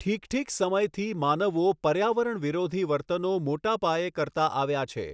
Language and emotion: Gujarati, neutral